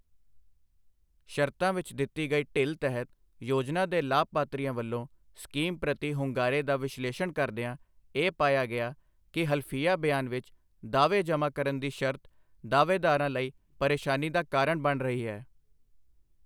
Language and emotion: Punjabi, neutral